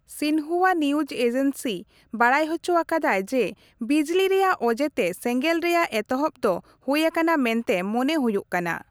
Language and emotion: Santali, neutral